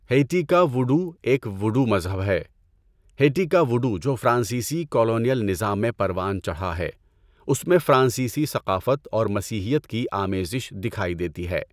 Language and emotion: Urdu, neutral